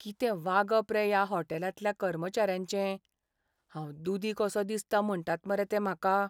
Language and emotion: Goan Konkani, sad